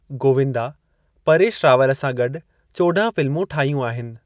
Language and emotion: Sindhi, neutral